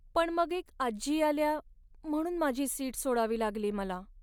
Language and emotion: Marathi, sad